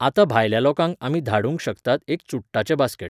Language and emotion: Goan Konkani, neutral